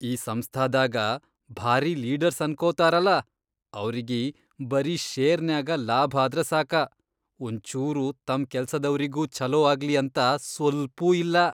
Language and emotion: Kannada, disgusted